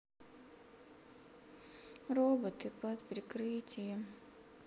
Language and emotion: Russian, sad